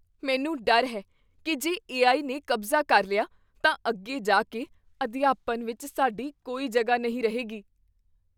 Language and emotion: Punjabi, fearful